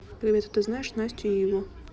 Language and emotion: Russian, neutral